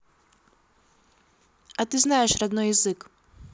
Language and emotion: Russian, neutral